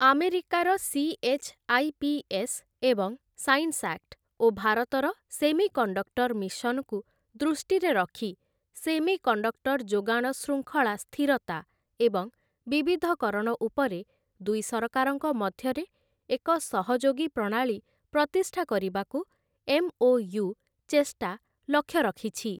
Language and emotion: Odia, neutral